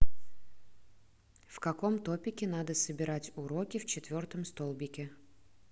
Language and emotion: Russian, neutral